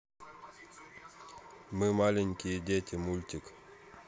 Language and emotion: Russian, neutral